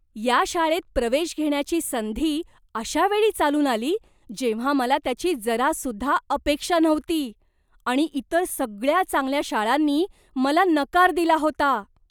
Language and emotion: Marathi, surprised